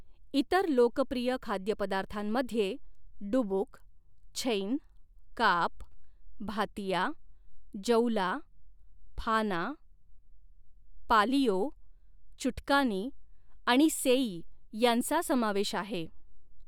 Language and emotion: Marathi, neutral